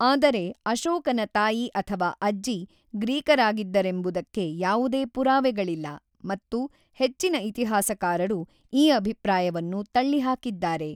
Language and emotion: Kannada, neutral